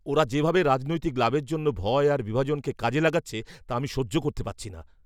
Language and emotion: Bengali, angry